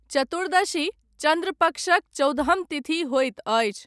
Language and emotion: Maithili, neutral